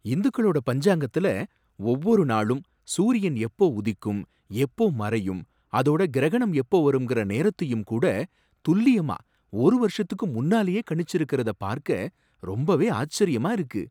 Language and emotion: Tamil, surprised